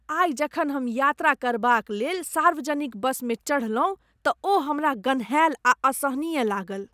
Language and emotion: Maithili, disgusted